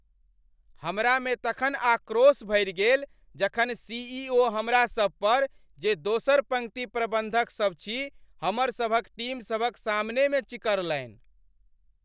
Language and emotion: Maithili, angry